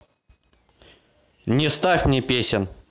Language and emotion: Russian, angry